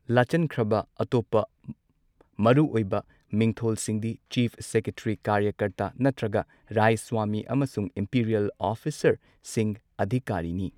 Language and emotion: Manipuri, neutral